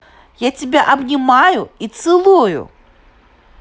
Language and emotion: Russian, positive